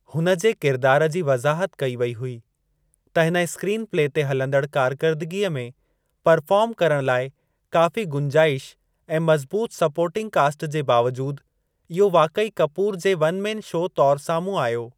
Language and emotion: Sindhi, neutral